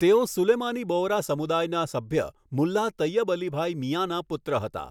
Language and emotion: Gujarati, neutral